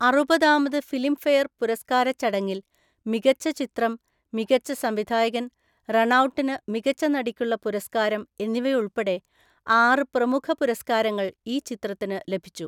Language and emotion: Malayalam, neutral